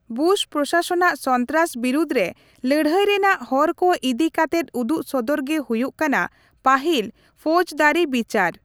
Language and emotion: Santali, neutral